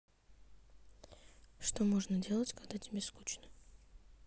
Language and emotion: Russian, neutral